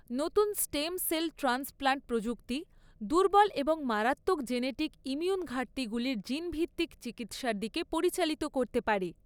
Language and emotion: Bengali, neutral